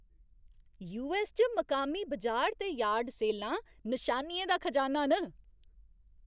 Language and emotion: Dogri, happy